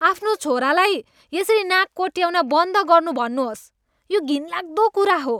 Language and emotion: Nepali, disgusted